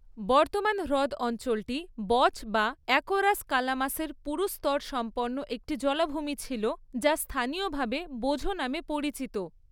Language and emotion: Bengali, neutral